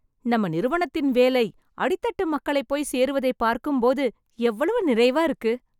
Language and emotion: Tamil, happy